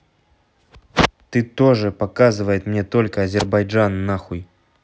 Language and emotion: Russian, angry